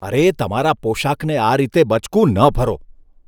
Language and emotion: Gujarati, disgusted